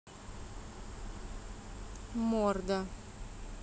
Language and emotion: Russian, neutral